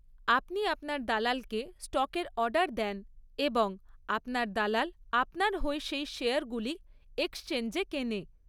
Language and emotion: Bengali, neutral